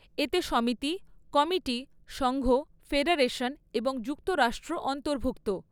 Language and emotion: Bengali, neutral